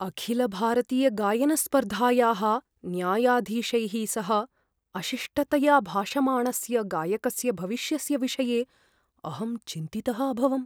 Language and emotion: Sanskrit, fearful